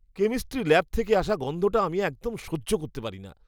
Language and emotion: Bengali, disgusted